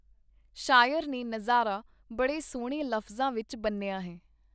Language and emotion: Punjabi, neutral